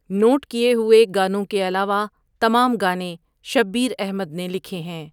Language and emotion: Urdu, neutral